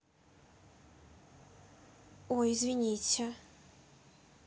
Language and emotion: Russian, neutral